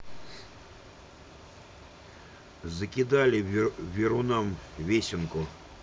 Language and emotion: Russian, neutral